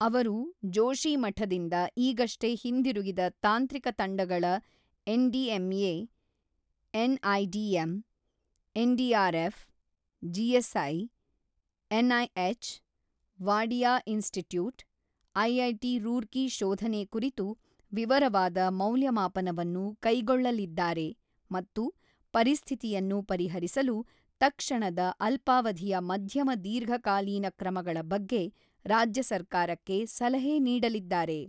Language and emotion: Kannada, neutral